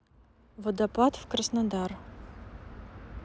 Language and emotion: Russian, neutral